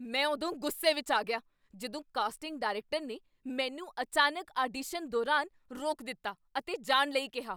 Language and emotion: Punjabi, angry